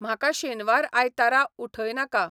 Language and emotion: Goan Konkani, neutral